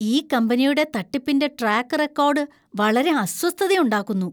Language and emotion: Malayalam, disgusted